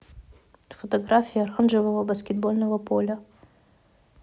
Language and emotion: Russian, neutral